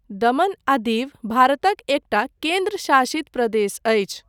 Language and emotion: Maithili, neutral